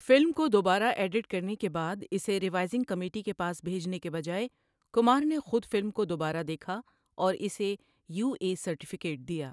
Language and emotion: Urdu, neutral